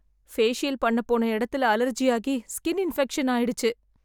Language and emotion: Tamil, sad